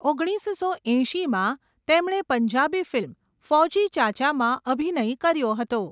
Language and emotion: Gujarati, neutral